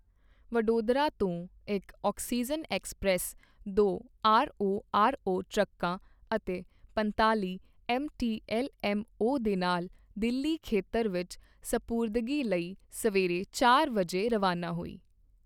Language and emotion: Punjabi, neutral